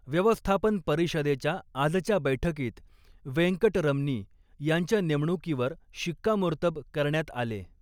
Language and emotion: Marathi, neutral